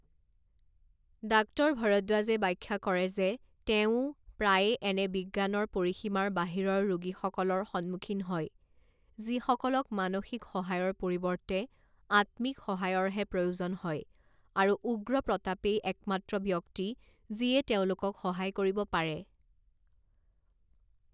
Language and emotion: Assamese, neutral